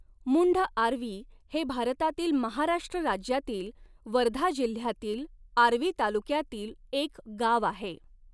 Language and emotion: Marathi, neutral